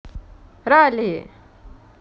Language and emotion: Russian, positive